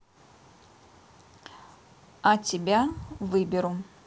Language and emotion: Russian, neutral